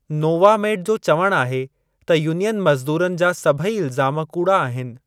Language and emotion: Sindhi, neutral